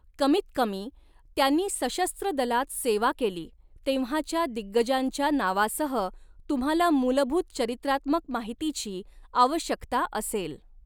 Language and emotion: Marathi, neutral